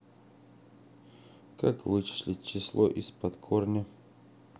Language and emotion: Russian, neutral